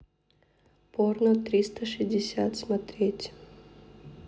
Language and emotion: Russian, neutral